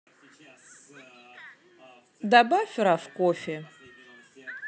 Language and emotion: Russian, neutral